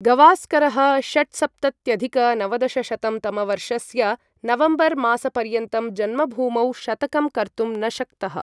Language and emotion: Sanskrit, neutral